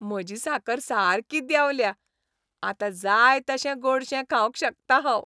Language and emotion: Goan Konkani, happy